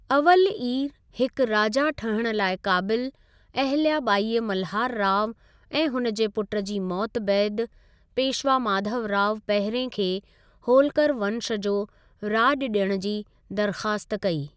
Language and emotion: Sindhi, neutral